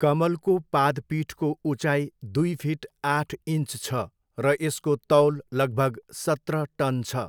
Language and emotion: Nepali, neutral